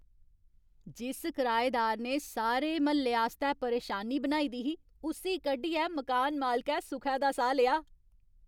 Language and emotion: Dogri, happy